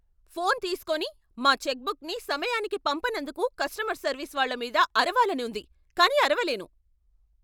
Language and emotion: Telugu, angry